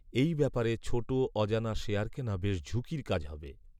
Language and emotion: Bengali, neutral